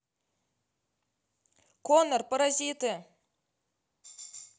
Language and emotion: Russian, neutral